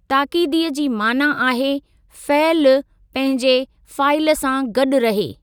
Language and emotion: Sindhi, neutral